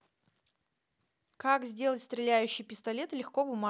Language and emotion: Russian, neutral